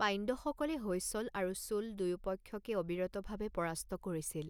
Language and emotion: Assamese, neutral